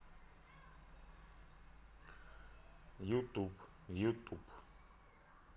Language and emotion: Russian, neutral